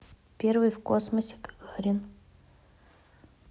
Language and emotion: Russian, neutral